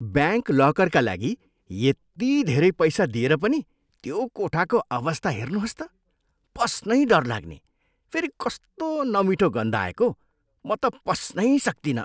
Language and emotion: Nepali, disgusted